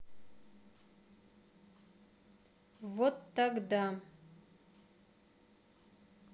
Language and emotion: Russian, neutral